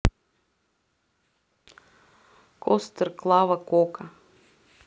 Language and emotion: Russian, neutral